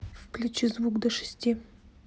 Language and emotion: Russian, neutral